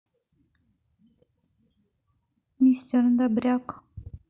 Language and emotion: Russian, neutral